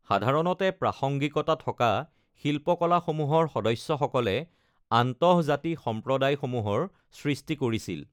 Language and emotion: Assamese, neutral